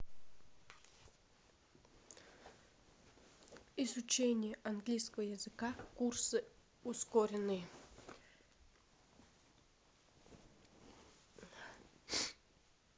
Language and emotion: Russian, neutral